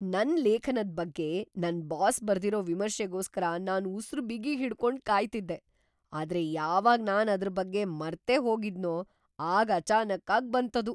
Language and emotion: Kannada, surprised